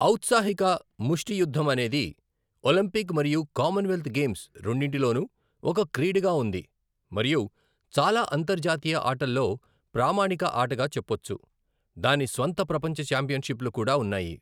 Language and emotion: Telugu, neutral